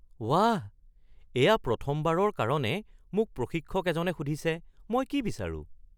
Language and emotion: Assamese, surprised